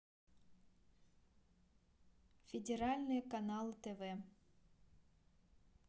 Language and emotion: Russian, neutral